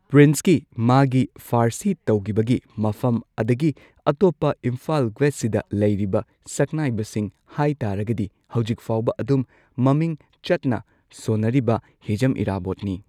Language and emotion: Manipuri, neutral